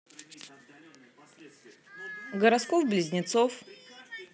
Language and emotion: Russian, neutral